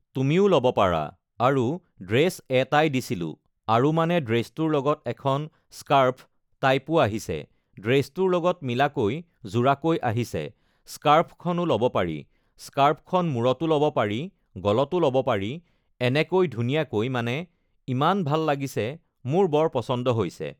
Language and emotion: Assamese, neutral